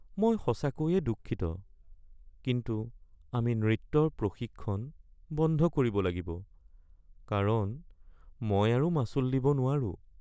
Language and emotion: Assamese, sad